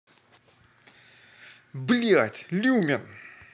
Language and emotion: Russian, angry